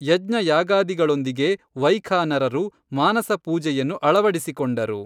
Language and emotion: Kannada, neutral